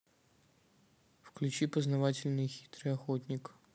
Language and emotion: Russian, neutral